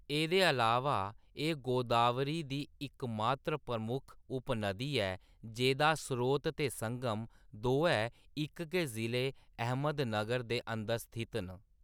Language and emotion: Dogri, neutral